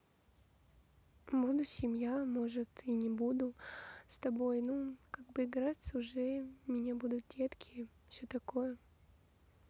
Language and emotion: Russian, sad